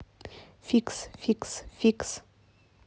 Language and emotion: Russian, neutral